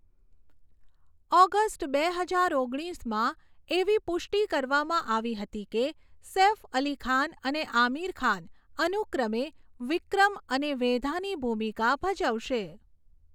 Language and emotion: Gujarati, neutral